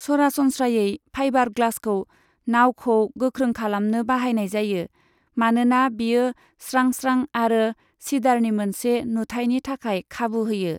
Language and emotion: Bodo, neutral